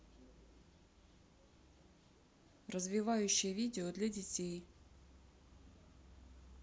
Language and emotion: Russian, neutral